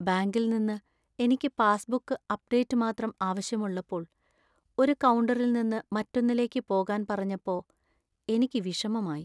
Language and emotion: Malayalam, sad